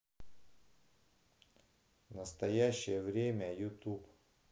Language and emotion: Russian, neutral